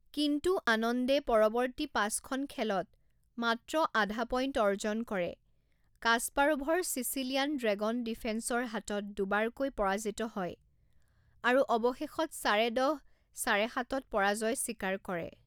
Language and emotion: Assamese, neutral